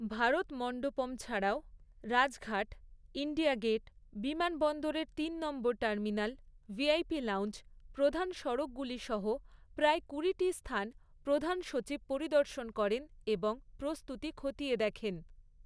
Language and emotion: Bengali, neutral